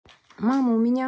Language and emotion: Russian, neutral